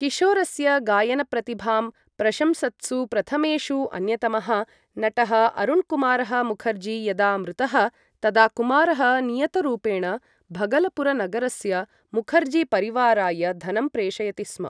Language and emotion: Sanskrit, neutral